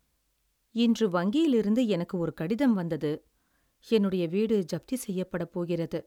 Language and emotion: Tamil, sad